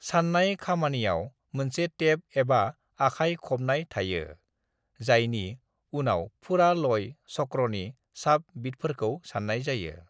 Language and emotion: Bodo, neutral